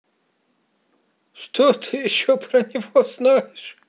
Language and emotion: Russian, positive